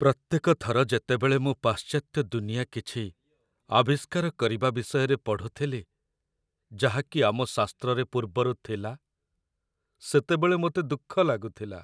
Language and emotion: Odia, sad